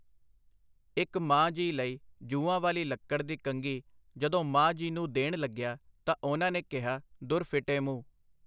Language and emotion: Punjabi, neutral